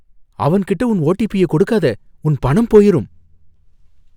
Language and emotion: Tamil, fearful